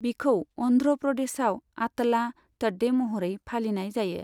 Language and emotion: Bodo, neutral